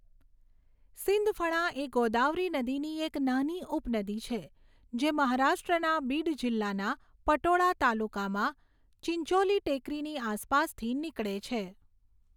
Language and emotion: Gujarati, neutral